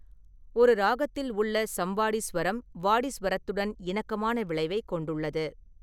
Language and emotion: Tamil, neutral